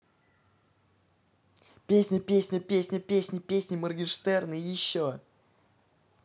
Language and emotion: Russian, positive